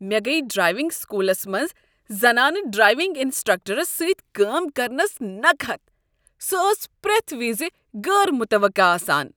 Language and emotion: Kashmiri, disgusted